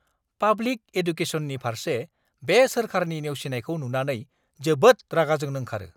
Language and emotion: Bodo, angry